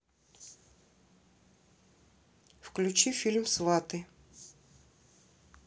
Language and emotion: Russian, neutral